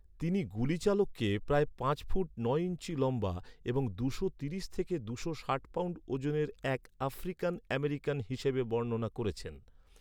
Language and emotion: Bengali, neutral